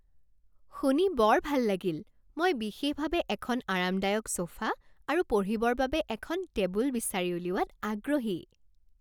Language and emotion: Assamese, happy